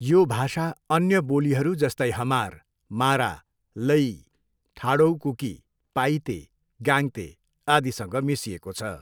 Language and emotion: Nepali, neutral